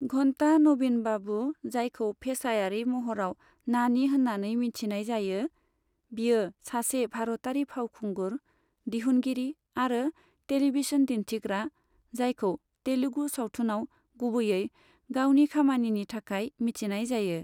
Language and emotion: Bodo, neutral